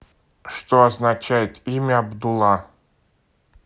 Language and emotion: Russian, neutral